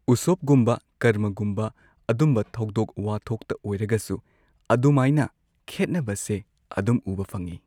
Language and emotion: Manipuri, neutral